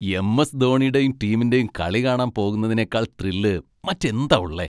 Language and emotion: Malayalam, happy